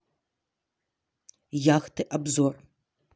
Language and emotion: Russian, neutral